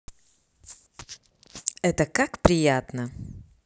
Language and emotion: Russian, positive